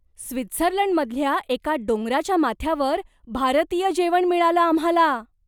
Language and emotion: Marathi, surprised